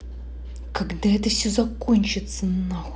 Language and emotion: Russian, angry